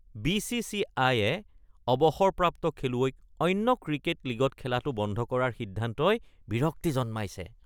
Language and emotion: Assamese, disgusted